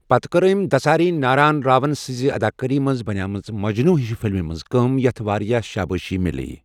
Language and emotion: Kashmiri, neutral